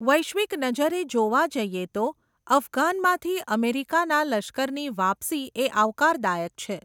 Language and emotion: Gujarati, neutral